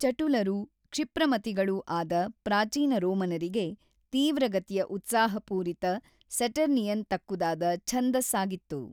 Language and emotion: Kannada, neutral